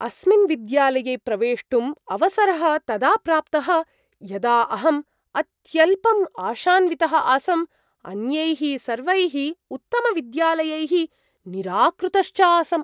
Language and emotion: Sanskrit, surprised